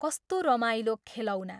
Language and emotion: Nepali, neutral